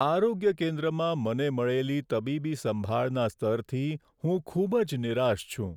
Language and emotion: Gujarati, sad